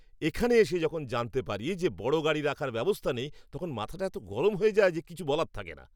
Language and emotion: Bengali, angry